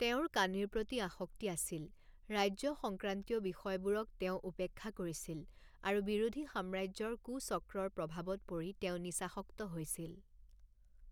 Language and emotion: Assamese, neutral